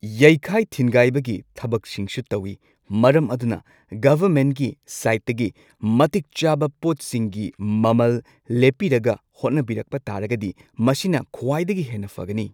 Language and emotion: Manipuri, neutral